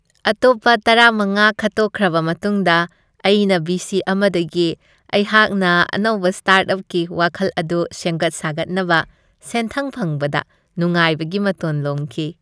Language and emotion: Manipuri, happy